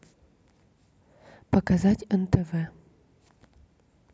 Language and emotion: Russian, neutral